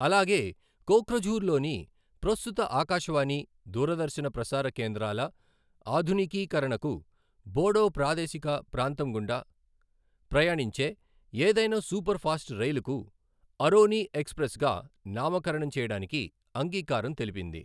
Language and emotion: Telugu, neutral